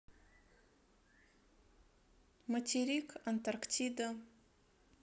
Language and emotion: Russian, neutral